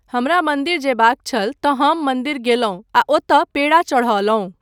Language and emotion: Maithili, neutral